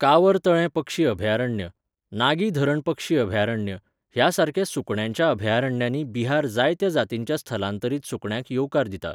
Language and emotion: Goan Konkani, neutral